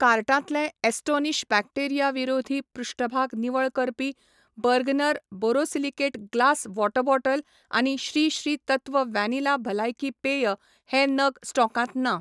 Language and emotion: Goan Konkani, neutral